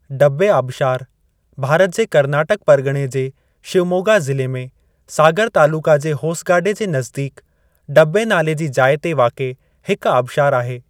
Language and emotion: Sindhi, neutral